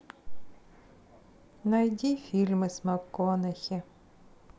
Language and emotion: Russian, sad